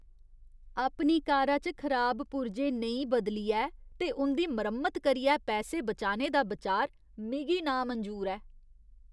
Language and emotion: Dogri, disgusted